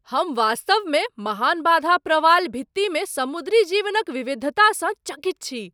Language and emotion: Maithili, surprised